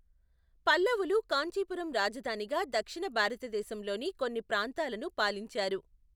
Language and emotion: Telugu, neutral